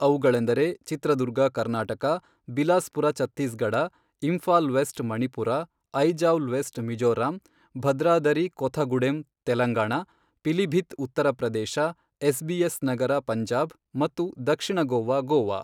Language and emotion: Kannada, neutral